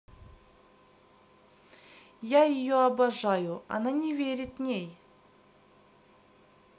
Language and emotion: Russian, neutral